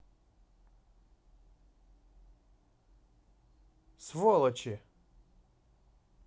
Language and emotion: Russian, angry